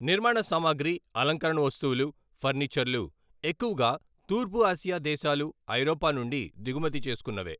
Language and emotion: Telugu, neutral